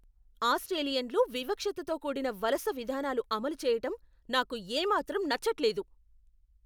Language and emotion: Telugu, angry